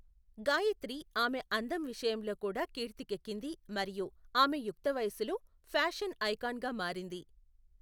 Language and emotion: Telugu, neutral